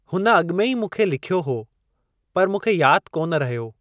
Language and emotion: Sindhi, neutral